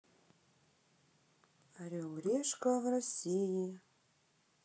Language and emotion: Russian, neutral